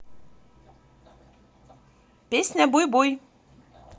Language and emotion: Russian, positive